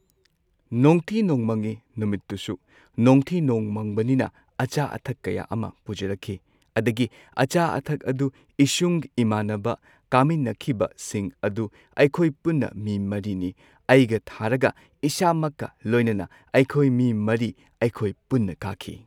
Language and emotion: Manipuri, neutral